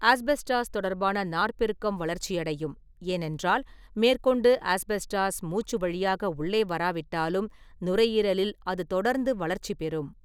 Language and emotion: Tamil, neutral